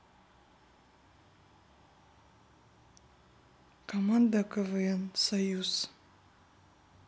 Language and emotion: Russian, neutral